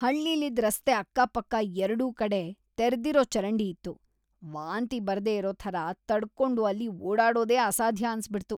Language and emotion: Kannada, disgusted